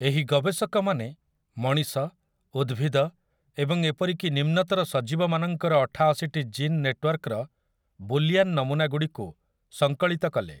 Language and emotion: Odia, neutral